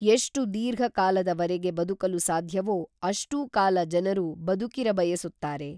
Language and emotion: Kannada, neutral